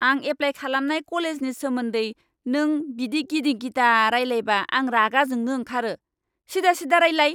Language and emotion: Bodo, angry